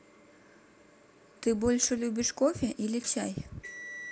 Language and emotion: Russian, neutral